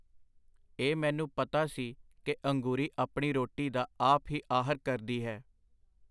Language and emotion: Punjabi, neutral